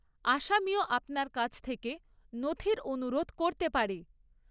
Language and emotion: Bengali, neutral